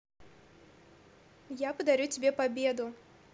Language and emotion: Russian, neutral